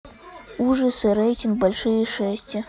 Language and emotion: Russian, neutral